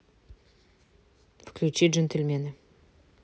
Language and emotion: Russian, neutral